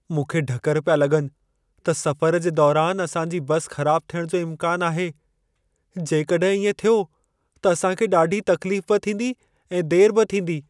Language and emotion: Sindhi, fearful